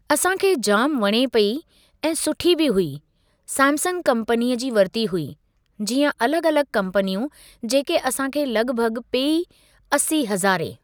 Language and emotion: Sindhi, neutral